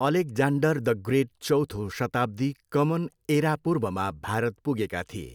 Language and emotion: Nepali, neutral